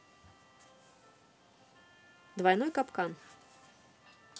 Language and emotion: Russian, neutral